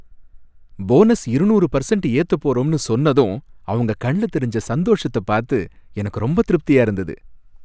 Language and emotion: Tamil, happy